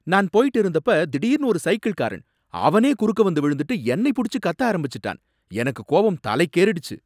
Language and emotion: Tamil, angry